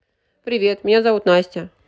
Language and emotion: Russian, neutral